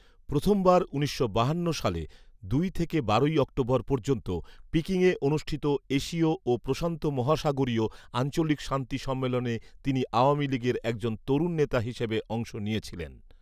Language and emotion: Bengali, neutral